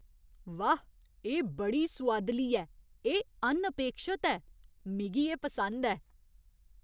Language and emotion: Dogri, surprised